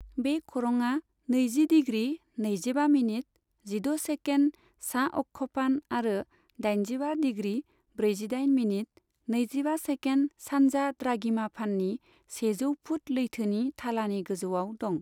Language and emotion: Bodo, neutral